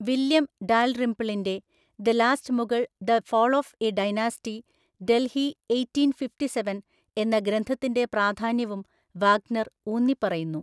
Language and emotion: Malayalam, neutral